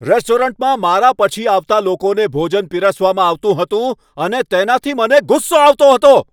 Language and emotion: Gujarati, angry